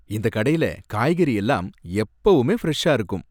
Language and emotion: Tamil, happy